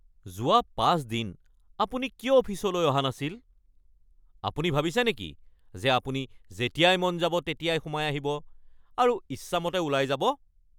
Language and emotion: Assamese, angry